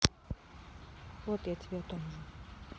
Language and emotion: Russian, sad